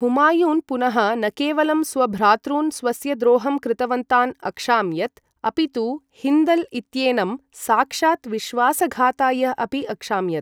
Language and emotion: Sanskrit, neutral